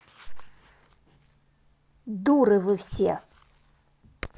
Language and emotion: Russian, angry